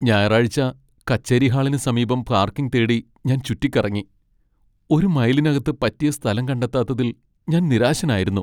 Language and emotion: Malayalam, sad